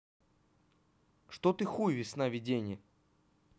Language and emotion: Russian, neutral